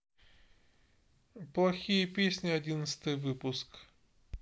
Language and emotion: Russian, neutral